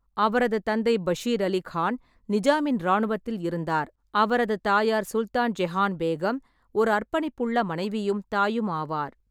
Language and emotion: Tamil, neutral